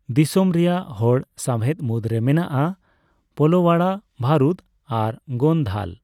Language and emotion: Santali, neutral